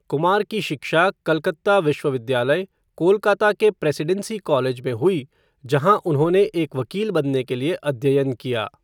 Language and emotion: Hindi, neutral